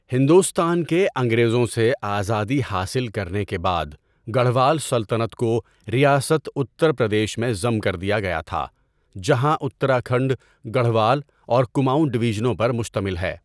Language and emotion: Urdu, neutral